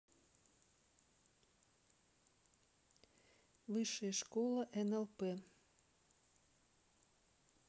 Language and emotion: Russian, neutral